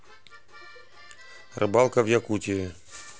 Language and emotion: Russian, neutral